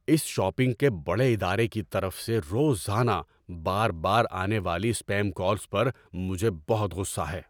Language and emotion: Urdu, angry